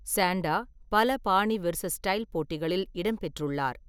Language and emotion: Tamil, neutral